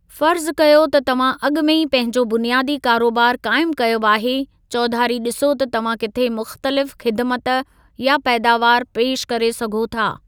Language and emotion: Sindhi, neutral